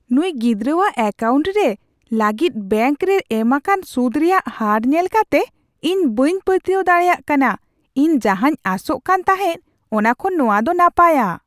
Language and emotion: Santali, surprised